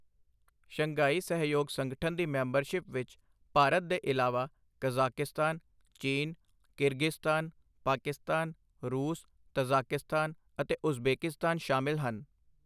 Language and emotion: Punjabi, neutral